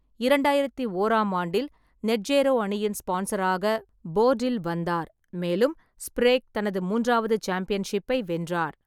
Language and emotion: Tamil, neutral